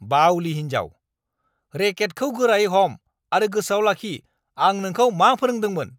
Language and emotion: Bodo, angry